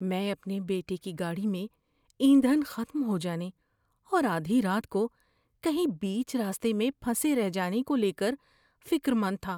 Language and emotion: Urdu, fearful